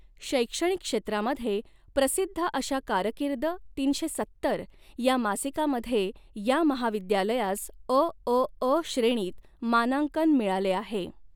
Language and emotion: Marathi, neutral